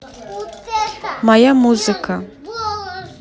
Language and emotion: Russian, neutral